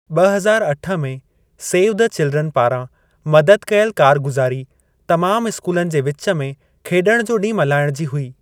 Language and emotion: Sindhi, neutral